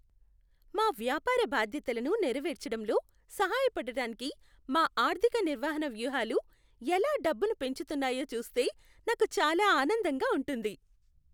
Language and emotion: Telugu, happy